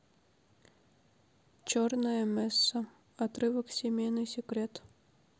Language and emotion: Russian, neutral